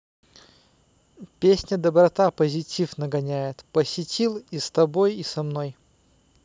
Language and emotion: Russian, neutral